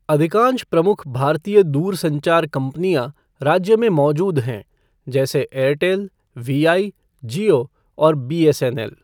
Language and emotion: Hindi, neutral